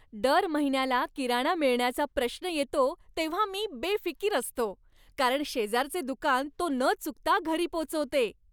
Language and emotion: Marathi, happy